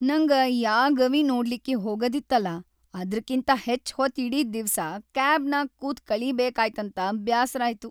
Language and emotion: Kannada, sad